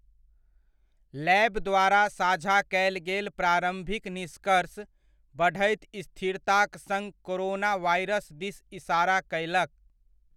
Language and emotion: Maithili, neutral